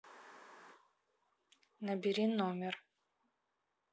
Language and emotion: Russian, neutral